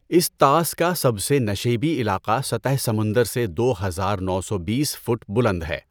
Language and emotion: Urdu, neutral